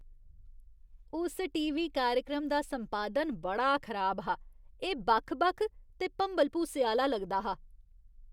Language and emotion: Dogri, disgusted